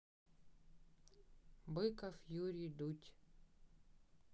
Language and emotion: Russian, neutral